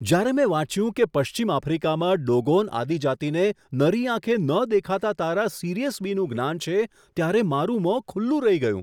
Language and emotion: Gujarati, surprised